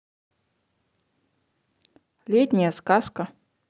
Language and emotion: Russian, neutral